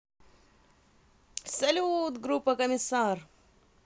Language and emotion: Russian, positive